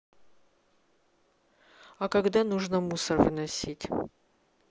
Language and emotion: Russian, neutral